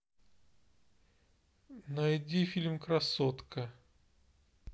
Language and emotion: Russian, neutral